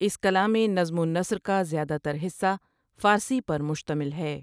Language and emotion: Urdu, neutral